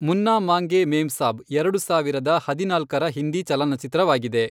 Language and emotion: Kannada, neutral